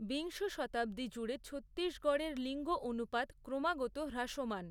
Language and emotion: Bengali, neutral